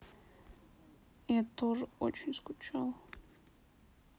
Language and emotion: Russian, sad